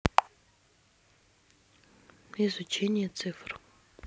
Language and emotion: Russian, neutral